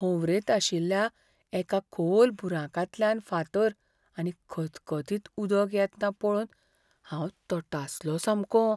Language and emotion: Goan Konkani, fearful